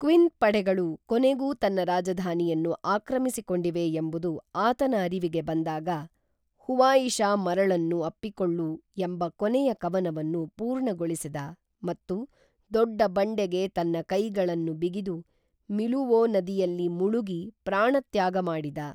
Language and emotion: Kannada, neutral